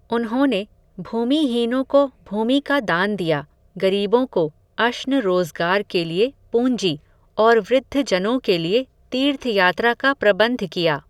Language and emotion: Hindi, neutral